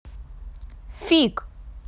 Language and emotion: Russian, angry